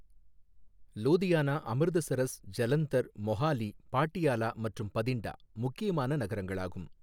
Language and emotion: Tamil, neutral